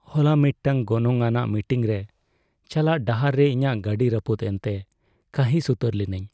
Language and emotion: Santali, sad